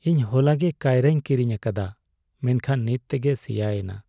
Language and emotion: Santali, sad